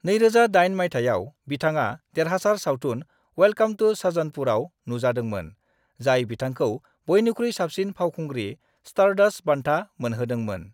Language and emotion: Bodo, neutral